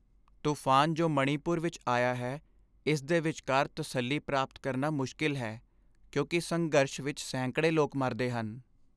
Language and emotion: Punjabi, sad